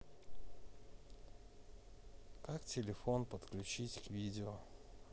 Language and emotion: Russian, neutral